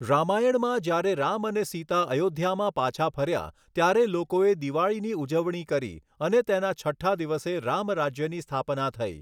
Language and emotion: Gujarati, neutral